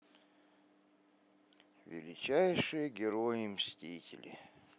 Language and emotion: Russian, sad